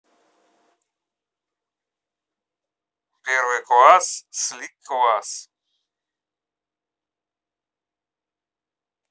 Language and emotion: Russian, neutral